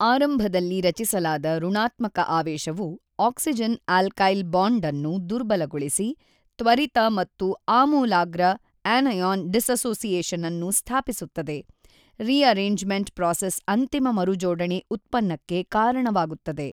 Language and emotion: Kannada, neutral